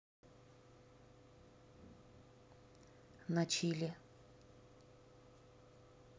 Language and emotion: Russian, neutral